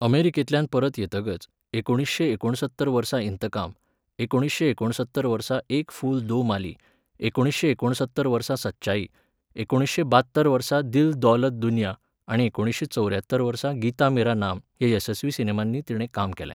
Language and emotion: Goan Konkani, neutral